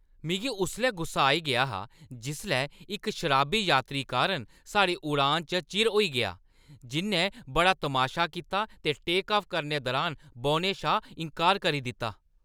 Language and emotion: Dogri, angry